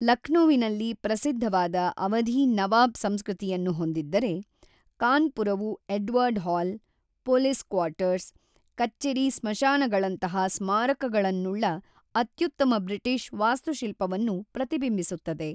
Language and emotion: Kannada, neutral